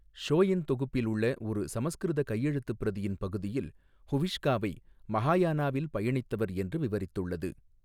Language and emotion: Tamil, neutral